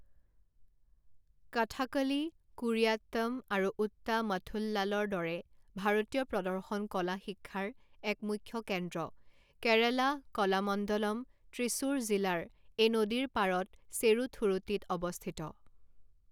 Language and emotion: Assamese, neutral